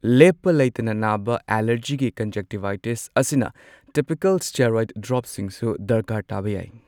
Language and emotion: Manipuri, neutral